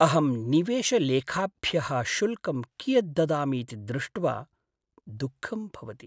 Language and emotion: Sanskrit, sad